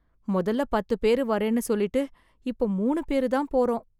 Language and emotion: Tamil, sad